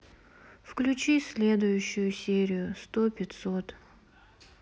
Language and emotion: Russian, sad